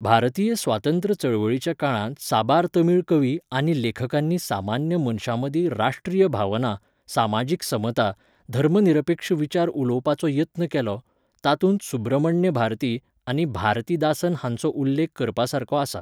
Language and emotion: Goan Konkani, neutral